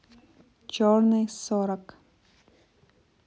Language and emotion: Russian, neutral